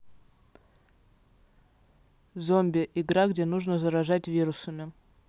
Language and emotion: Russian, neutral